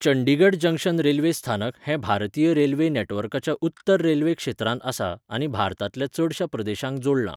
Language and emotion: Goan Konkani, neutral